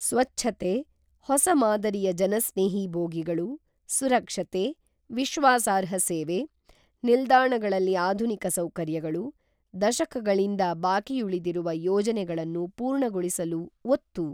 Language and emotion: Kannada, neutral